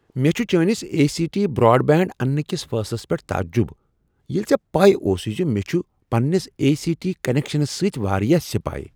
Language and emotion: Kashmiri, surprised